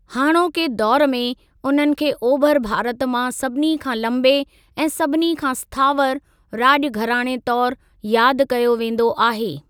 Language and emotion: Sindhi, neutral